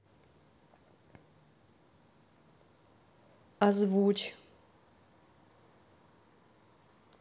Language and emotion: Russian, neutral